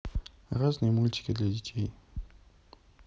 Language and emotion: Russian, neutral